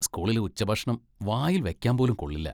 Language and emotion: Malayalam, disgusted